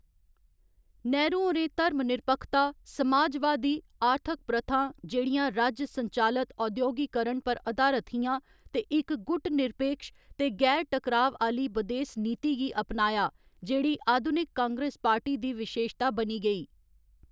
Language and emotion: Dogri, neutral